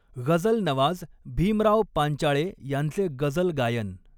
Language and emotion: Marathi, neutral